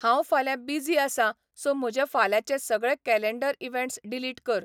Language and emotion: Goan Konkani, neutral